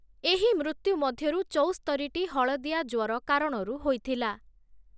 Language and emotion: Odia, neutral